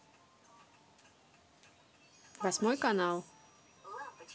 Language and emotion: Russian, neutral